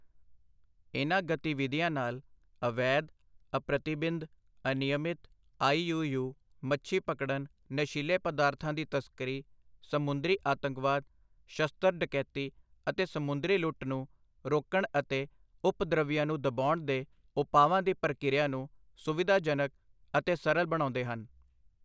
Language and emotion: Punjabi, neutral